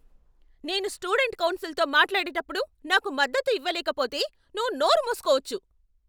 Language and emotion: Telugu, angry